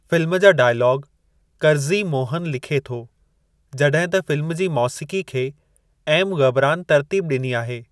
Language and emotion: Sindhi, neutral